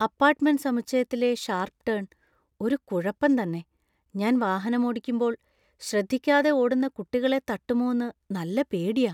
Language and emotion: Malayalam, fearful